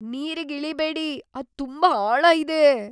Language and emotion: Kannada, fearful